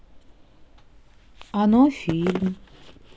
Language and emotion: Russian, sad